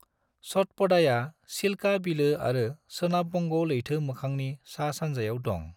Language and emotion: Bodo, neutral